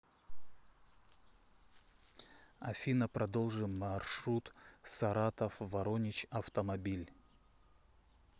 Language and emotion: Russian, neutral